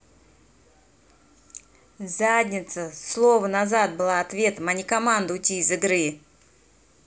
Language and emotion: Russian, angry